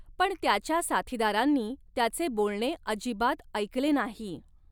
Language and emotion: Marathi, neutral